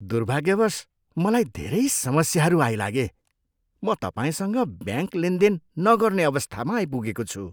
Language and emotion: Nepali, disgusted